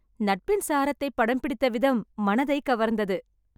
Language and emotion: Tamil, happy